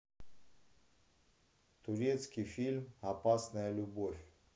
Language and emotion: Russian, neutral